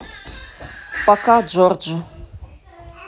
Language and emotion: Russian, neutral